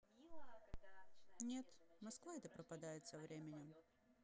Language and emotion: Russian, sad